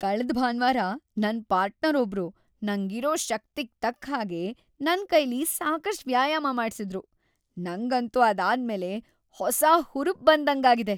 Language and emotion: Kannada, happy